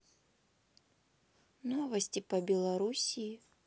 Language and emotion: Russian, neutral